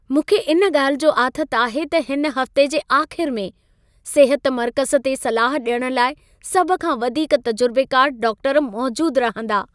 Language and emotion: Sindhi, happy